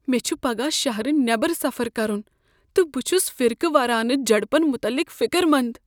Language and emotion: Kashmiri, fearful